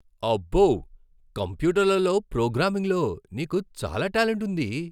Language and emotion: Telugu, surprised